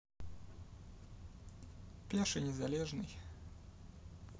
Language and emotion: Russian, neutral